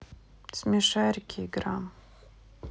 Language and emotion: Russian, neutral